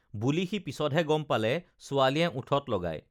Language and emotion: Assamese, neutral